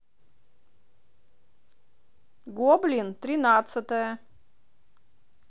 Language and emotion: Russian, neutral